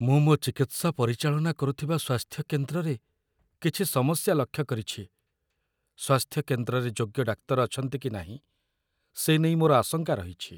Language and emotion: Odia, fearful